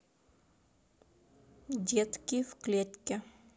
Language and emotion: Russian, neutral